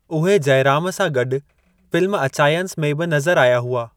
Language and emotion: Sindhi, neutral